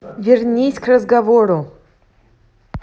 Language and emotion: Russian, angry